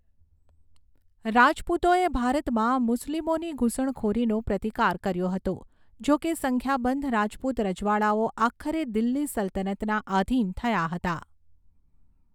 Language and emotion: Gujarati, neutral